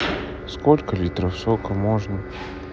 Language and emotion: Russian, neutral